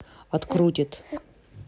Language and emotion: Russian, neutral